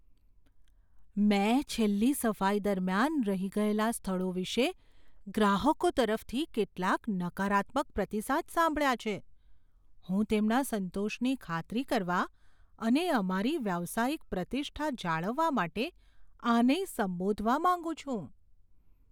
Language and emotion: Gujarati, fearful